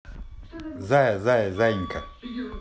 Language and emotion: Russian, positive